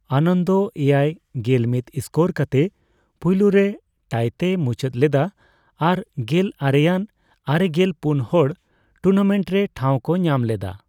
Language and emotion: Santali, neutral